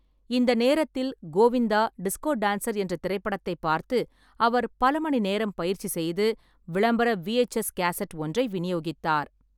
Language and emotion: Tamil, neutral